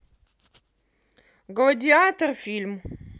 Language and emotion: Russian, neutral